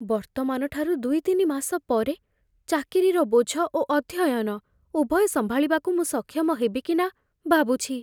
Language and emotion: Odia, fearful